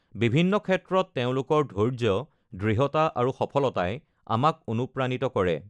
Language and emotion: Assamese, neutral